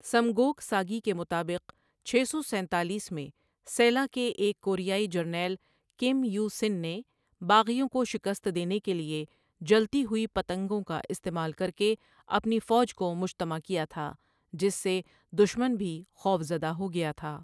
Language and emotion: Urdu, neutral